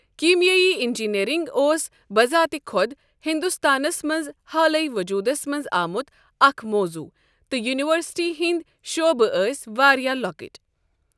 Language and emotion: Kashmiri, neutral